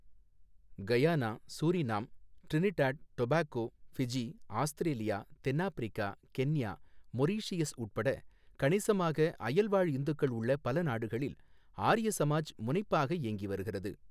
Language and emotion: Tamil, neutral